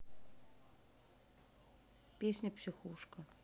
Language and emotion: Russian, neutral